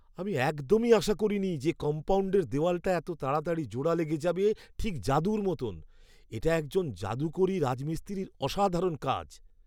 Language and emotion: Bengali, surprised